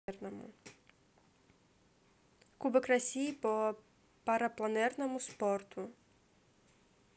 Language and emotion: Russian, neutral